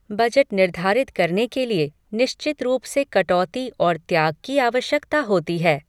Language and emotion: Hindi, neutral